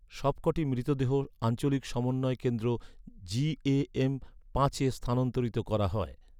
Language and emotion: Bengali, neutral